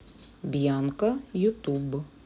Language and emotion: Russian, neutral